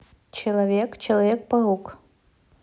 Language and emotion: Russian, neutral